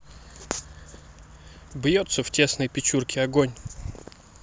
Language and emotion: Russian, neutral